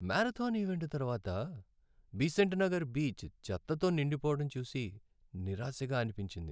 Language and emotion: Telugu, sad